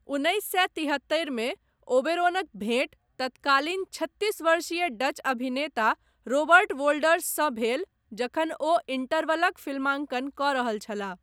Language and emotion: Maithili, neutral